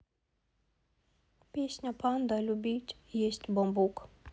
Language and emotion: Russian, neutral